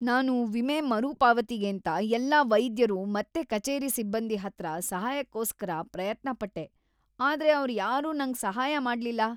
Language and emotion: Kannada, disgusted